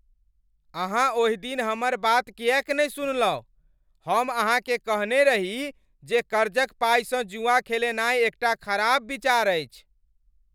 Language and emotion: Maithili, angry